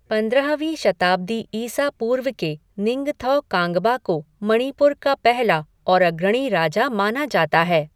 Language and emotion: Hindi, neutral